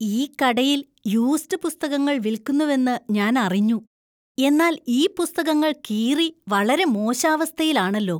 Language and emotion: Malayalam, disgusted